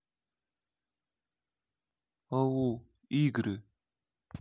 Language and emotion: Russian, neutral